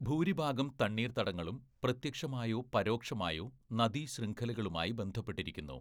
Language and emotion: Malayalam, neutral